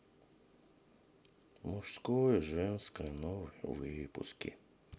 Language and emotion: Russian, sad